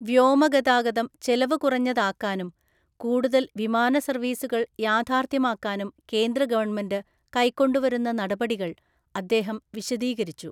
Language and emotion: Malayalam, neutral